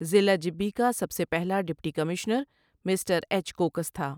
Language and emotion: Urdu, neutral